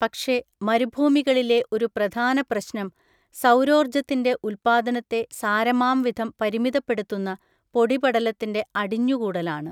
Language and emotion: Malayalam, neutral